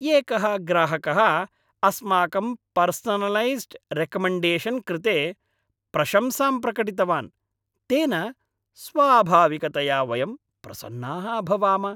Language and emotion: Sanskrit, happy